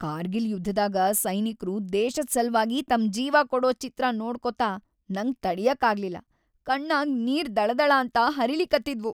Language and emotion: Kannada, sad